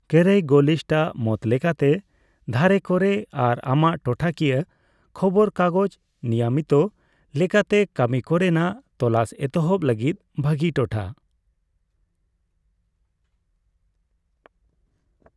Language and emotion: Santali, neutral